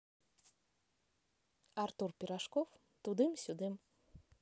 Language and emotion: Russian, neutral